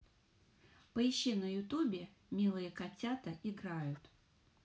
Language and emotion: Russian, positive